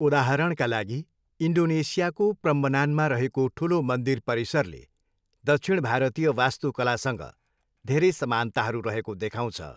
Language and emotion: Nepali, neutral